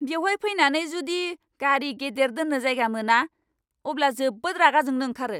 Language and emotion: Bodo, angry